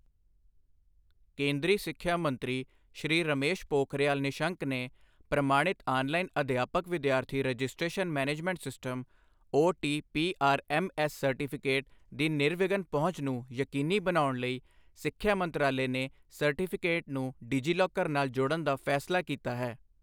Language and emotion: Punjabi, neutral